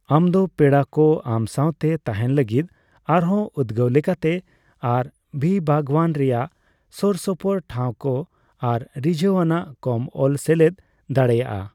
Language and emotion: Santali, neutral